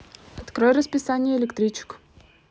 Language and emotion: Russian, neutral